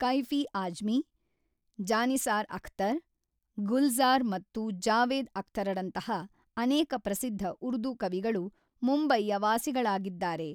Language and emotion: Kannada, neutral